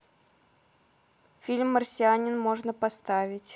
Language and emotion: Russian, neutral